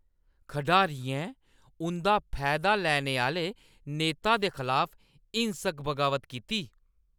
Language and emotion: Dogri, angry